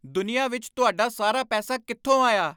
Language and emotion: Punjabi, angry